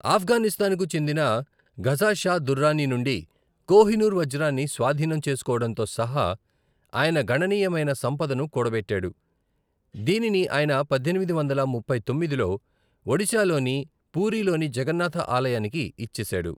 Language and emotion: Telugu, neutral